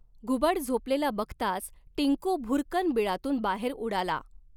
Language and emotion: Marathi, neutral